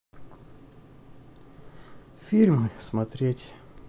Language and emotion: Russian, sad